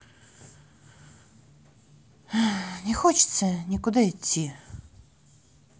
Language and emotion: Russian, sad